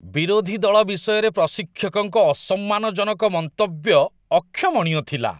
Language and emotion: Odia, disgusted